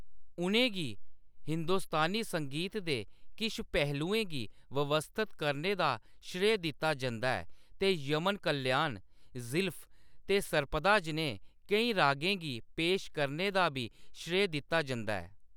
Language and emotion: Dogri, neutral